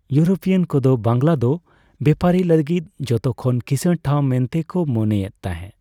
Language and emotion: Santali, neutral